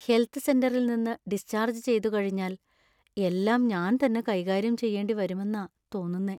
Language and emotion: Malayalam, sad